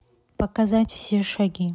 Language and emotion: Russian, neutral